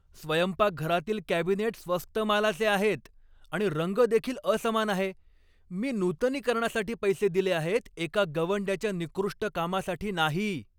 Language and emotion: Marathi, angry